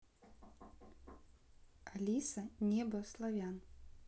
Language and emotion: Russian, neutral